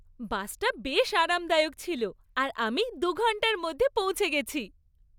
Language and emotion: Bengali, happy